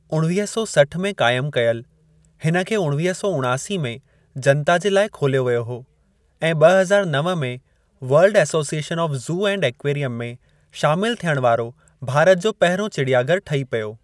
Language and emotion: Sindhi, neutral